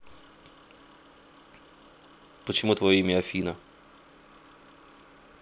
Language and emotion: Russian, neutral